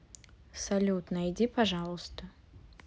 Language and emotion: Russian, sad